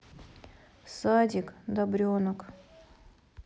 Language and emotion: Russian, neutral